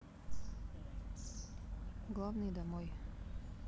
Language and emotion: Russian, sad